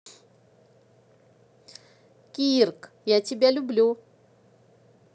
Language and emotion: Russian, positive